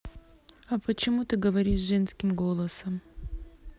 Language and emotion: Russian, neutral